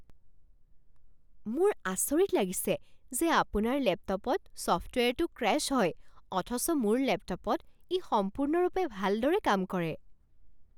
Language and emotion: Assamese, surprised